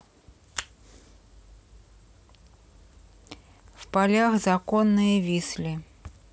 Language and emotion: Russian, neutral